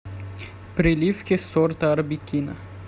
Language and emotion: Russian, neutral